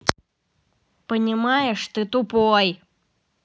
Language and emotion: Russian, angry